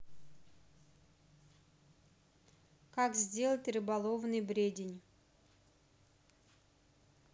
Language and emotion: Russian, neutral